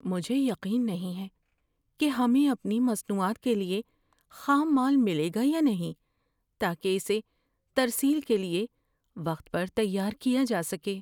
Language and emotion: Urdu, fearful